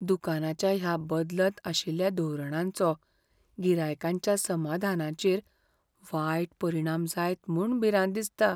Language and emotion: Goan Konkani, fearful